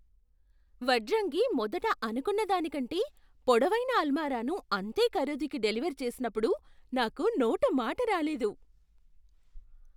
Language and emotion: Telugu, surprised